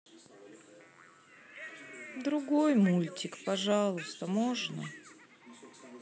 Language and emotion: Russian, sad